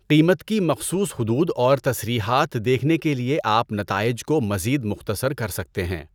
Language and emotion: Urdu, neutral